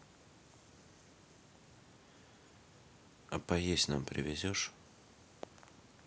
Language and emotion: Russian, neutral